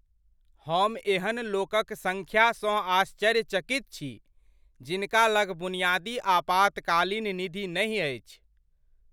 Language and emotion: Maithili, surprised